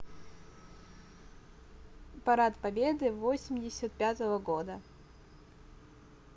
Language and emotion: Russian, neutral